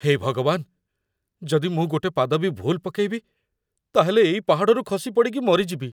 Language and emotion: Odia, fearful